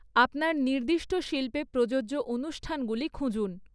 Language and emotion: Bengali, neutral